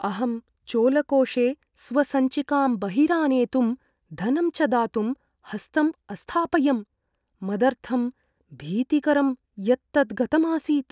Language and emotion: Sanskrit, fearful